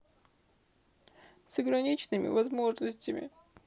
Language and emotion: Russian, sad